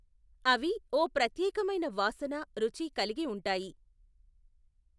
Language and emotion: Telugu, neutral